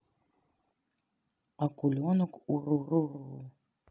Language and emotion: Russian, neutral